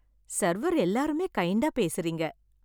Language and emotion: Tamil, happy